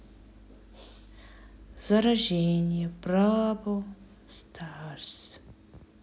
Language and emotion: Russian, neutral